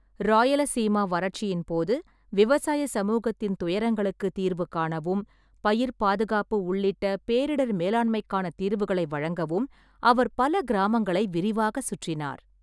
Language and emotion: Tamil, neutral